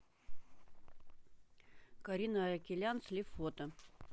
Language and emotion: Russian, neutral